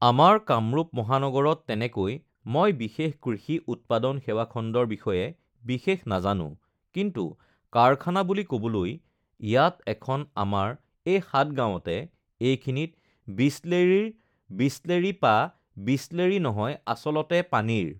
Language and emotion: Assamese, neutral